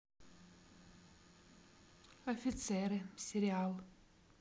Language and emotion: Russian, neutral